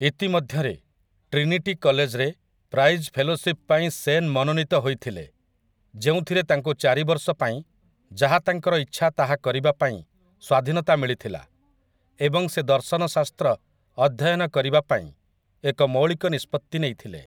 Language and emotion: Odia, neutral